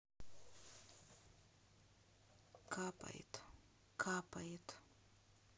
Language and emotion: Russian, sad